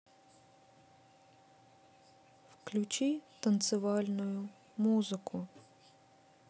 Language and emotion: Russian, sad